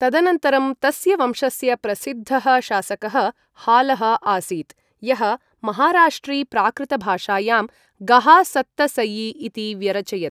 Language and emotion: Sanskrit, neutral